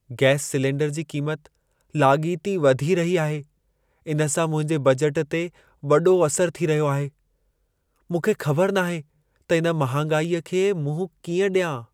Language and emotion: Sindhi, sad